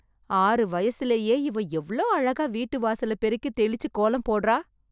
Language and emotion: Tamil, surprised